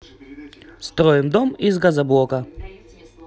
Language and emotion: Russian, positive